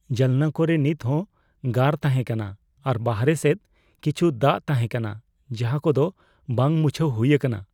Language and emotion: Santali, fearful